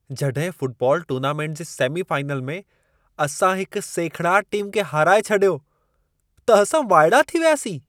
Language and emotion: Sindhi, surprised